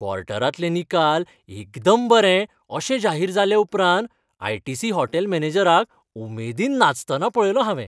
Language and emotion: Goan Konkani, happy